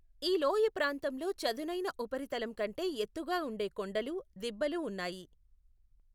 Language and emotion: Telugu, neutral